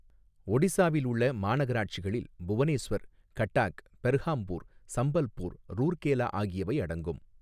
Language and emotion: Tamil, neutral